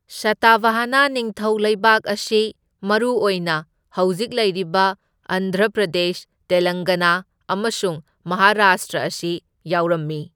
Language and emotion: Manipuri, neutral